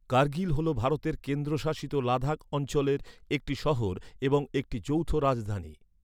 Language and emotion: Bengali, neutral